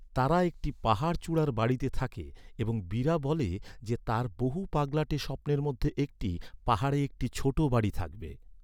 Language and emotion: Bengali, neutral